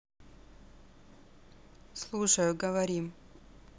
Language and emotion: Russian, neutral